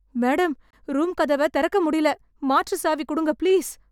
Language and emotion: Tamil, fearful